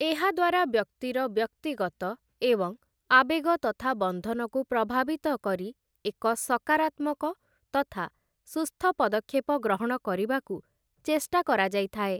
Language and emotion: Odia, neutral